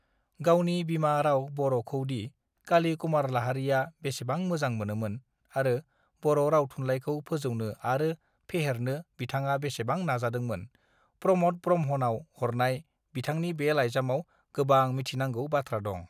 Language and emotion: Bodo, neutral